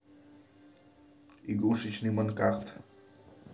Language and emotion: Russian, neutral